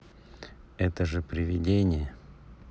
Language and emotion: Russian, neutral